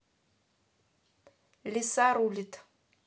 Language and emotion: Russian, neutral